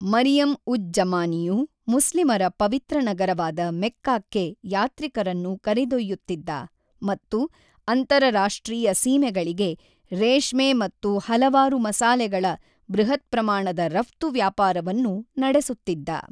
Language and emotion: Kannada, neutral